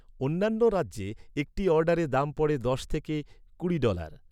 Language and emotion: Bengali, neutral